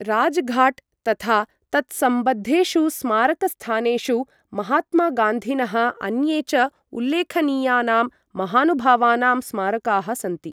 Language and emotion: Sanskrit, neutral